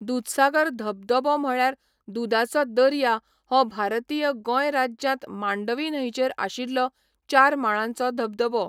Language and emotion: Goan Konkani, neutral